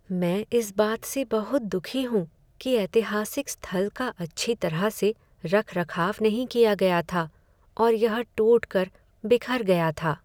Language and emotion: Hindi, sad